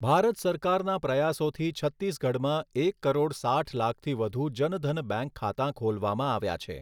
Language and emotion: Gujarati, neutral